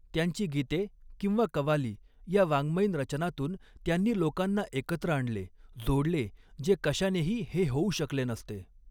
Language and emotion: Marathi, neutral